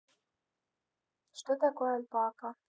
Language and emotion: Russian, neutral